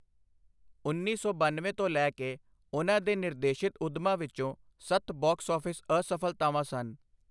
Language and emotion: Punjabi, neutral